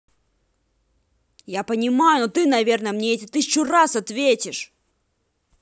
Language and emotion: Russian, angry